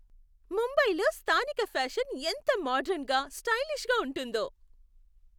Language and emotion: Telugu, happy